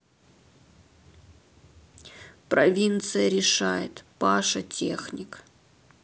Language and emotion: Russian, sad